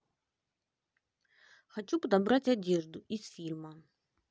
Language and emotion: Russian, neutral